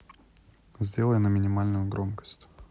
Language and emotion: Russian, neutral